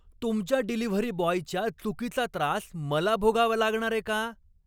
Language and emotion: Marathi, angry